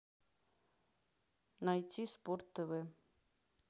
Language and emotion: Russian, neutral